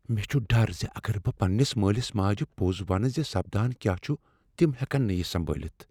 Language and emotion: Kashmiri, fearful